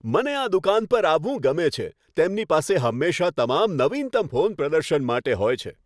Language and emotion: Gujarati, happy